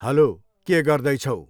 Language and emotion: Nepali, neutral